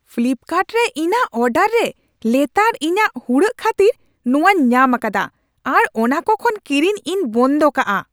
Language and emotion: Santali, angry